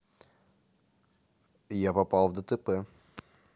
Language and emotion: Russian, neutral